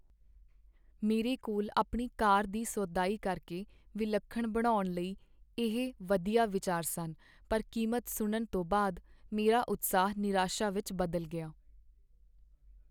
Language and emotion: Punjabi, sad